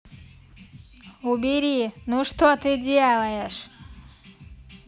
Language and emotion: Russian, angry